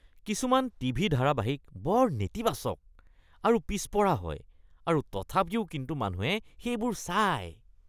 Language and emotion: Assamese, disgusted